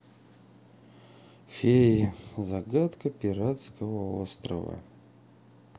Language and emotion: Russian, sad